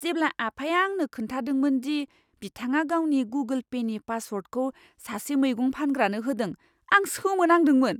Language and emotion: Bodo, surprised